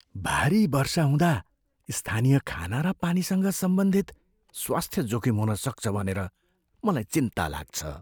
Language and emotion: Nepali, fearful